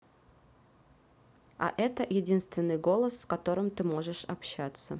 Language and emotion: Russian, neutral